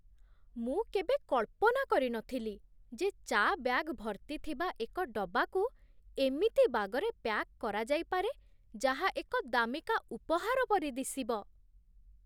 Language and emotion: Odia, surprised